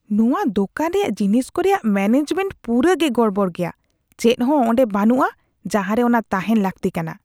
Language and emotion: Santali, disgusted